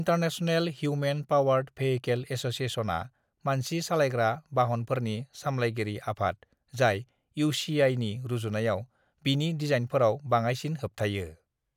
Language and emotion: Bodo, neutral